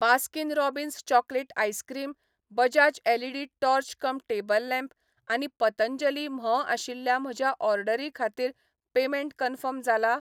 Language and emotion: Goan Konkani, neutral